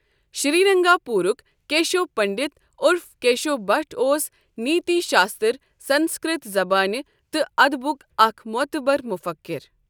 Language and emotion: Kashmiri, neutral